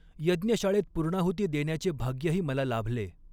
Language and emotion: Marathi, neutral